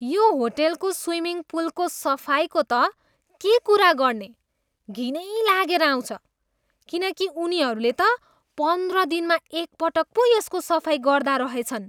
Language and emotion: Nepali, disgusted